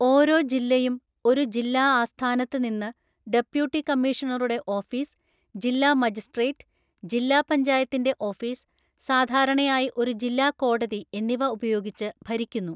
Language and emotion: Malayalam, neutral